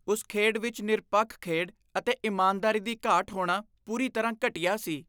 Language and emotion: Punjabi, disgusted